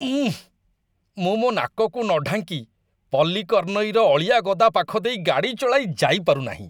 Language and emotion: Odia, disgusted